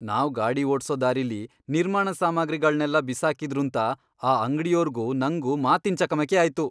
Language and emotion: Kannada, angry